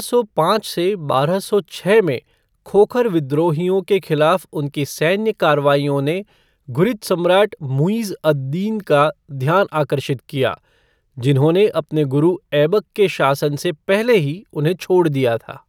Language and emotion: Hindi, neutral